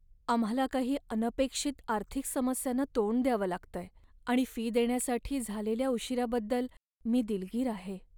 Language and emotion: Marathi, sad